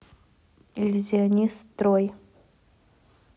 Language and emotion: Russian, neutral